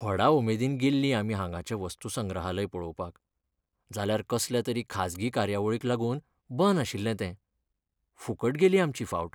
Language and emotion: Goan Konkani, sad